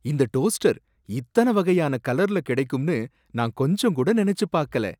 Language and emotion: Tamil, surprised